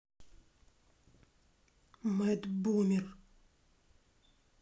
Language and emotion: Russian, angry